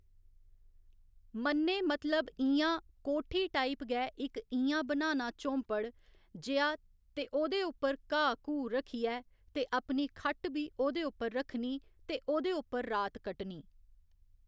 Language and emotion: Dogri, neutral